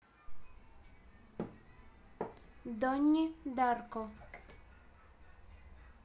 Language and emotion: Russian, neutral